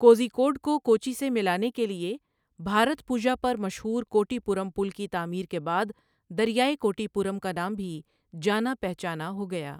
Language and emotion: Urdu, neutral